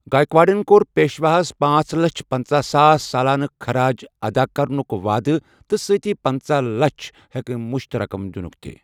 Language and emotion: Kashmiri, neutral